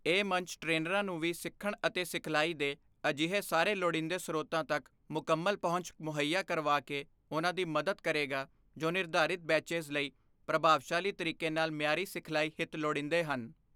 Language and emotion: Punjabi, neutral